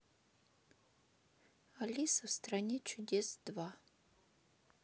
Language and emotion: Russian, neutral